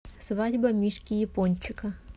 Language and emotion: Russian, neutral